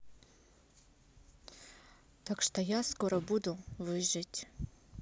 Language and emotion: Russian, neutral